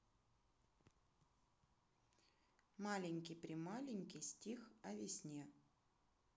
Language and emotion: Russian, neutral